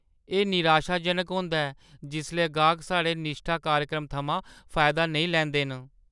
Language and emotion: Dogri, sad